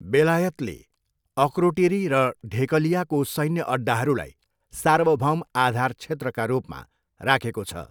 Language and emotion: Nepali, neutral